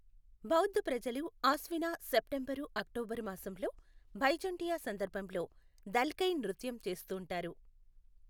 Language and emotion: Telugu, neutral